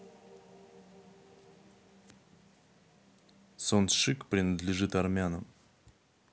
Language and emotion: Russian, neutral